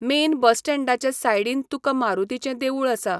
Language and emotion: Goan Konkani, neutral